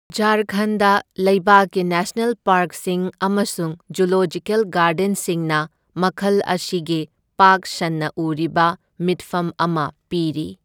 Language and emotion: Manipuri, neutral